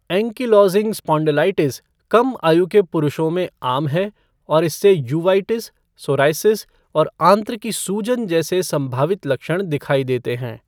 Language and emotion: Hindi, neutral